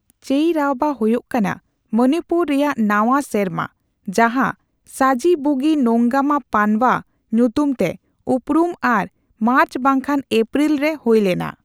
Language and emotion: Santali, neutral